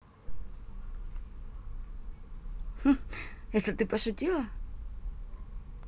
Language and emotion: Russian, positive